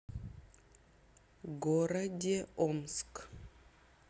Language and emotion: Russian, neutral